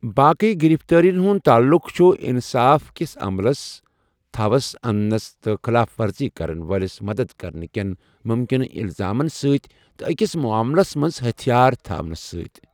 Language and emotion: Kashmiri, neutral